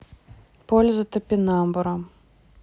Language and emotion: Russian, neutral